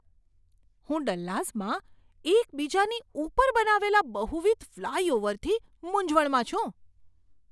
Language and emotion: Gujarati, surprised